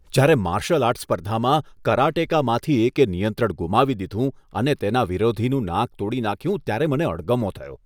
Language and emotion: Gujarati, disgusted